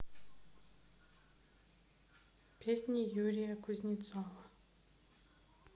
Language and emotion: Russian, sad